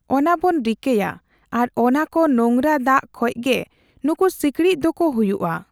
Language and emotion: Santali, neutral